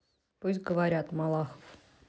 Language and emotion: Russian, neutral